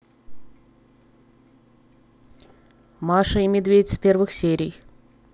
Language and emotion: Russian, neutral